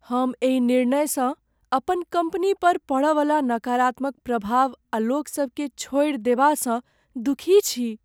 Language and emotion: Maithili, sad